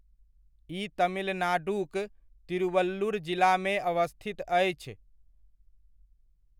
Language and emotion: Maithili, neutral